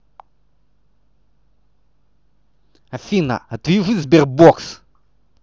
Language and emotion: Russian, angry